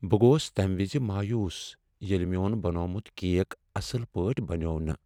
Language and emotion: Kashmiri, sad